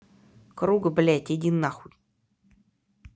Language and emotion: Russian, angry